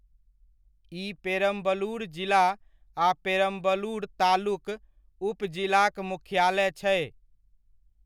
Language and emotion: Maithili, neutral